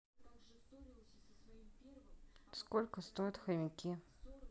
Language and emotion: Russian, neutral